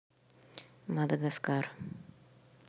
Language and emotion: Russian, neutral